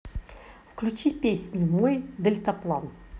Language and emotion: Russian, positive